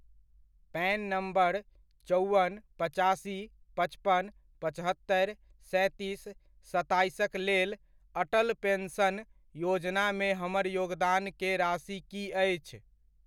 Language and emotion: Maithili, neutral